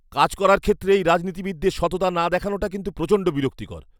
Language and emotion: Bengali, angry